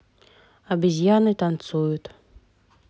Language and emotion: Russian, neutral